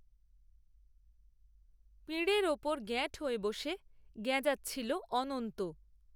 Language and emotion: Bengali, neutral